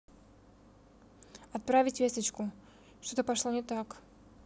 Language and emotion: Russian, neutral